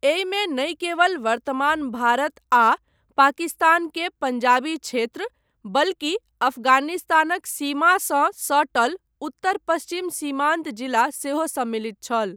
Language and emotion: Maithili, neutral